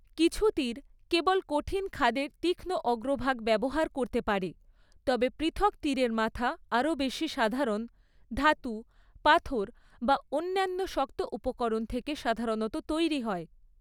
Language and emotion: Bengali, neutral